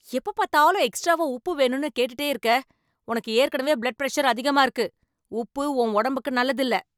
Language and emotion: Tamil, angry